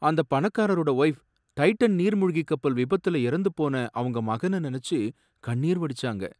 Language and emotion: Tamil, sad